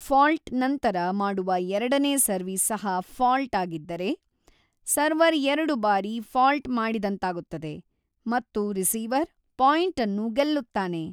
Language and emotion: Kannada, neutral